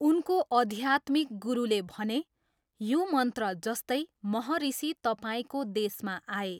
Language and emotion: Nepali, neutral